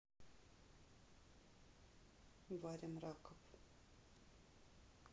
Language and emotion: Russian, neutral